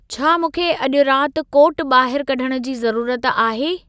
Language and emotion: Sindhi, neutral